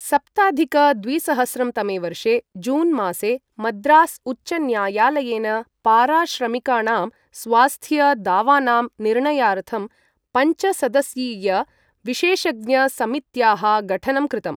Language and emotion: Sanskrit, neutral